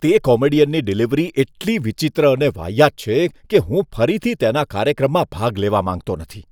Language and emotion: Gujarati, disgusted